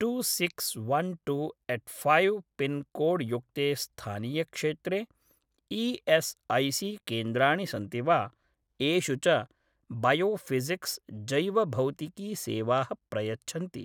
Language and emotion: Sanskrit, neutral